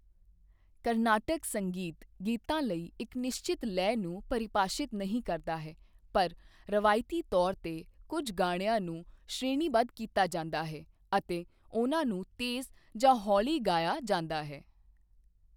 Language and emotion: Punjabi, neutral